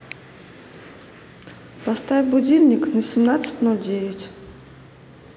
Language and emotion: Russian, neutral